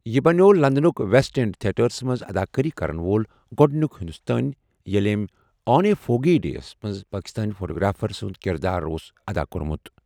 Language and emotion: Kashmiri, neutral